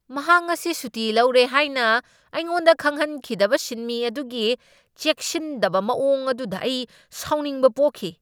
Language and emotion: Manipuri, angry